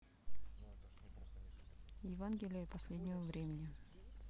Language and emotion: Russian, neutral